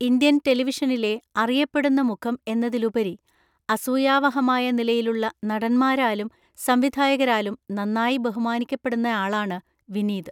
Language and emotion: Malayalam, neutral